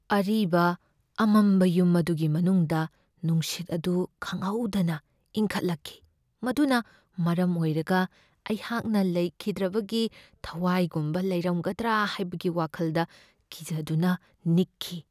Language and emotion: Manipuri, fearful